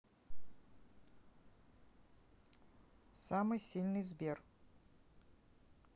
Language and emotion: Russian, neutral